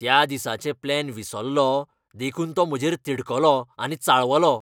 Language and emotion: Goan Konkani, angry